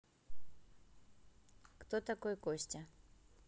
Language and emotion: Russian, neutral